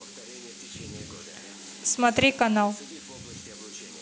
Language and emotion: Russian, neutral